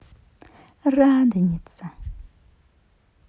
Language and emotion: Russian, positive